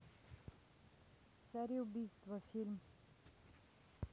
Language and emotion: Russian, neutral